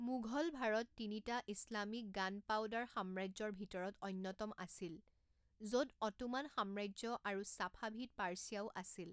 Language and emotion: Assamese, neutral